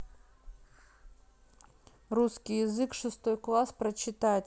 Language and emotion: Russian, neutral